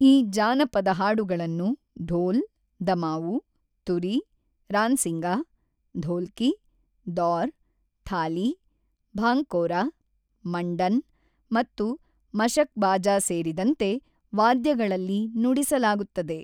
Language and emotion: Kannada, neutral